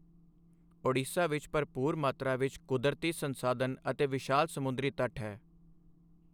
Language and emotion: Punjabi, neutral